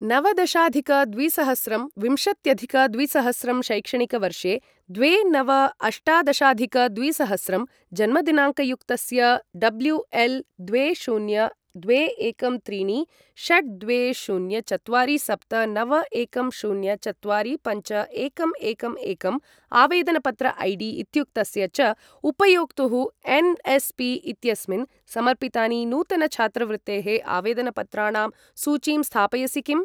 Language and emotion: Sanskrit, neutral